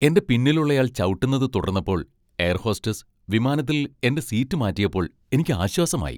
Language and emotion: Malayalam, happy